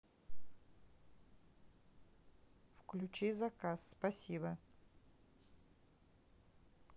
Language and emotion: Russian, neutral